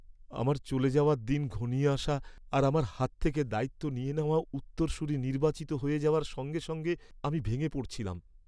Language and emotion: Bengali, sad